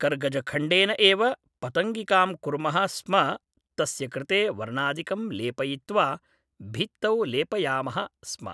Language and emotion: Sanskrit, neutral